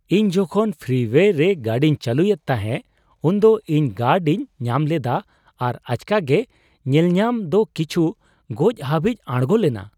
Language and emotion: Santali, surprised